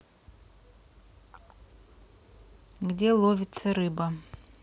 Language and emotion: Russian, neutral